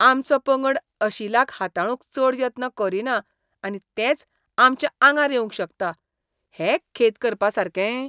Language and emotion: Goan Konkani, disgusted